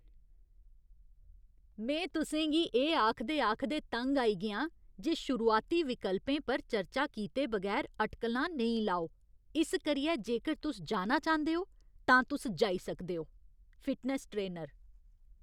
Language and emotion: Dogri, disgusted